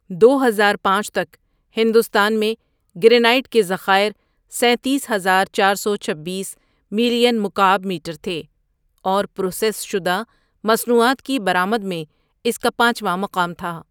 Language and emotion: Urdu, neutral